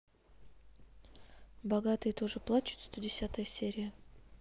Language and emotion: Russian, neutral